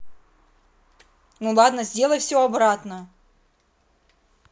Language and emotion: Russian, angry